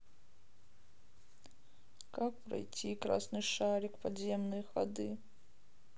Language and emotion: Russian, sad